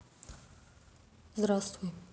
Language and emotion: Russian, neutral